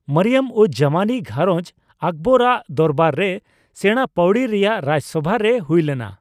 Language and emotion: Santali, neutral